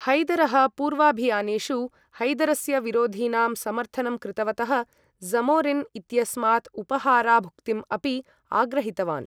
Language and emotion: Sanskrit, neutral